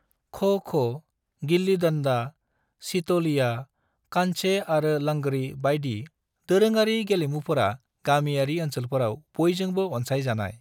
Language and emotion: Bodo, neutral